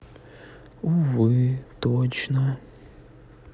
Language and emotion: Russian, sad